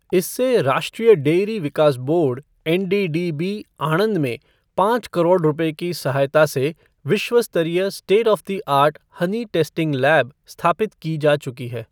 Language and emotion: Hindi, neutral